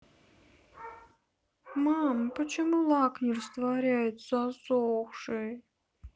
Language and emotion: Russian, sad